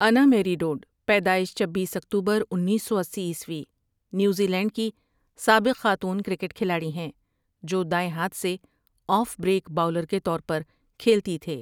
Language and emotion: Urdu, neutral